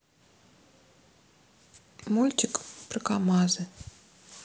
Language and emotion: Russian, sad